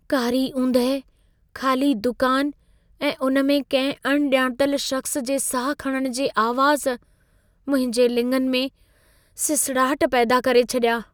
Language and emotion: Sindhi, fearful